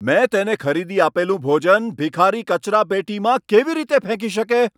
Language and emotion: Gujarati, angry